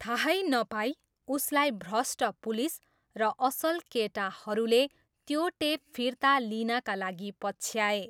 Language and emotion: Nepali, neutral